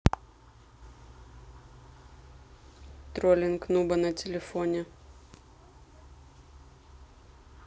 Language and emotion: Russian, neutral